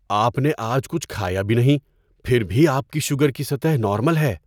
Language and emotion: Urdu, surprised